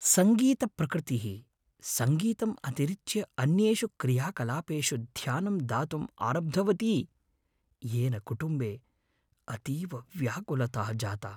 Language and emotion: Sanskrit, fearful